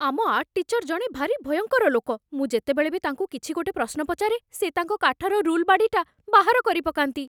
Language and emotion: Odia, fearful